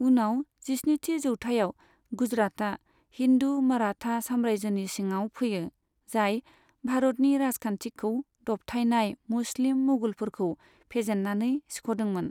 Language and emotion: Bodo, neutral